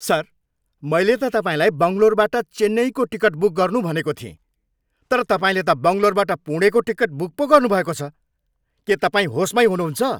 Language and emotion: Nepali, angry